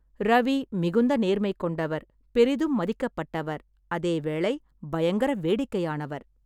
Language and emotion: Tamil, neutral